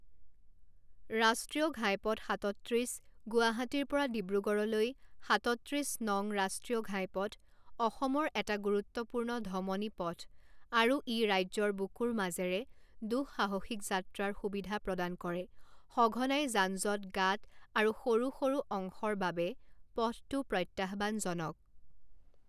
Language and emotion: Assamese, neutral